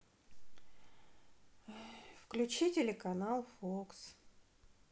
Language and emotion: Russian, sad